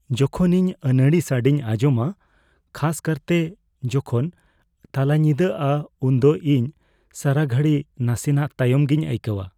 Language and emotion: Santali, fearful